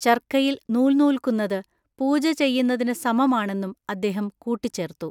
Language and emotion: Malayalam, neutral